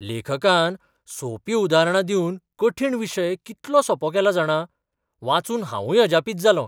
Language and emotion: Goan Konkani, surprised